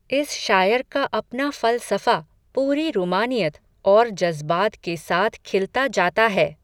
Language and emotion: Hindi, neutral